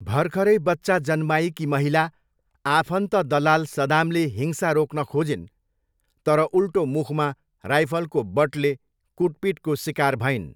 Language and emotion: Nepali, neutral